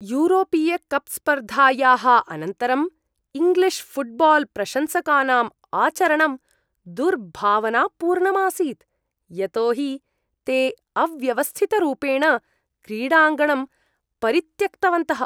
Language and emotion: Sanskrit, disgusted